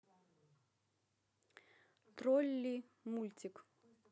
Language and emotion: Russian, neutral